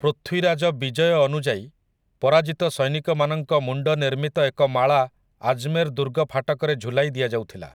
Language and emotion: Odia, neutral